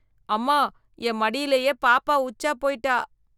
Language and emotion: Tamil, disgusted